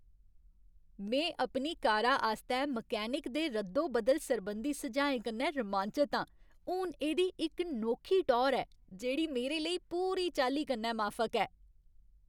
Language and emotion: Dogri, happy